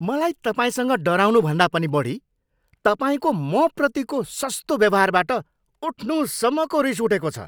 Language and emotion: Nepali, angry